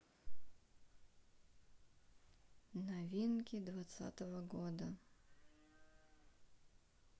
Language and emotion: Russian, sad